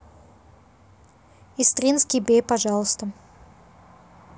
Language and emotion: Russian, neutral